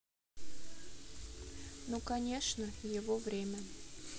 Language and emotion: Russian, neutral